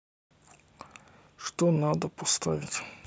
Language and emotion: Russian, neutral